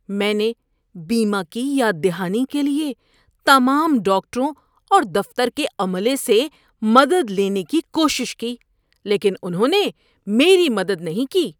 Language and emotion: Urdu, disgusted